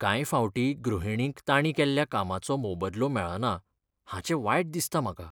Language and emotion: Goan Konkani, sad